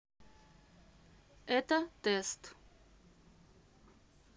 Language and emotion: Russian, neutral